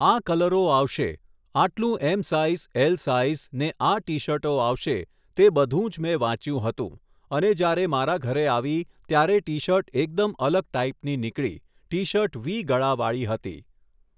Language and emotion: Gujarati, neutral